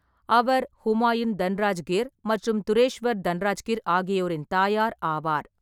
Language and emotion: Tamil, neutral